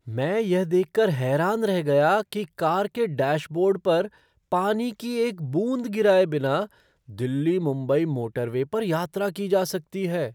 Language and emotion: Hindi, surprised